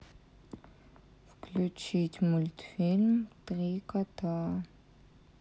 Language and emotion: Russian, neutral